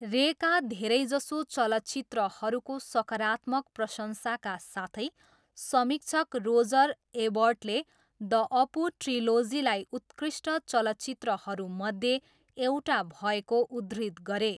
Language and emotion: Nepali, neutral